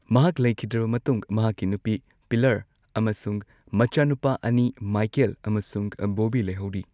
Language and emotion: Manipuri, neutral